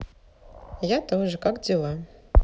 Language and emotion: Russian, neutral